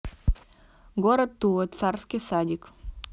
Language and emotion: Russian, neutral